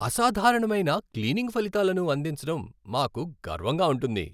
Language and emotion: Telugu, happy